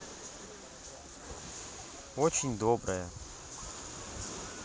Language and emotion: Russian, positive